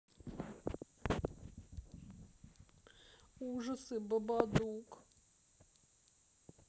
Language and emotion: Russian, sad